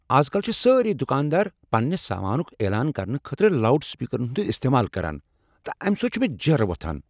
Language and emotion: Kashmiri, angry